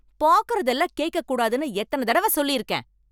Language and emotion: Tamil, angry